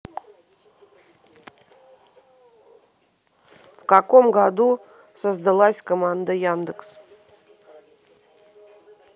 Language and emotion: Russian, neutral